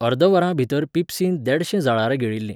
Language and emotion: Goan Konkani, neutral